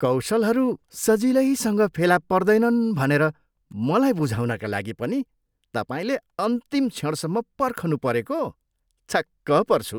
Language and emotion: Nepali, disgusted